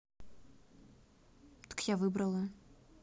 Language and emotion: Russian, neutral